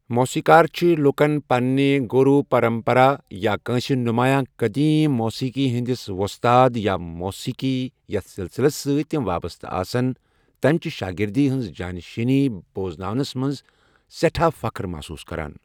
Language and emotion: Kashmiri, neutral